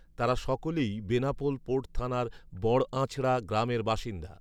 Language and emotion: Bengali, neutral